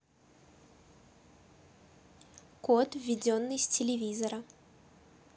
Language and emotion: Russian, neutral